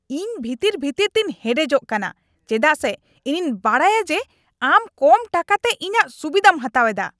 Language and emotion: Santali, angry